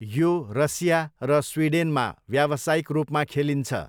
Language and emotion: Nepali, neutral